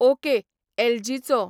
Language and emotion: Goan Konkani, neutral